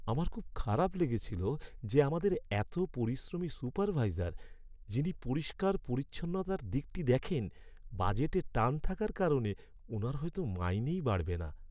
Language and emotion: Bengali, sad